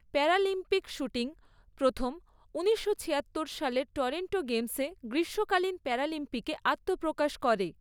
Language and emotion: Bengali, neutral